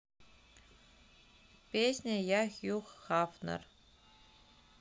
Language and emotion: Russian, neutral